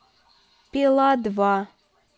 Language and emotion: Russian, neutral